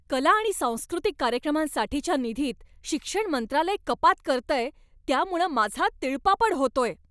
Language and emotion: Marathi, angry